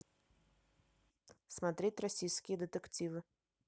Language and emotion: Russian, neutral